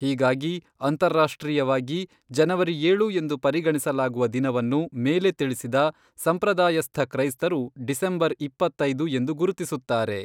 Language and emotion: Kannada, neutral